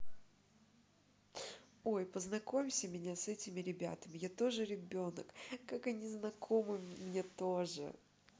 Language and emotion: Russian, positive